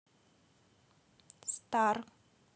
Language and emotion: Russian, neutral